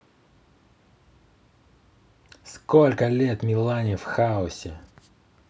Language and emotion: Russian, angry